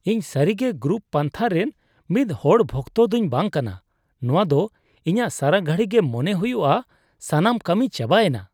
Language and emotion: Santali, disgusted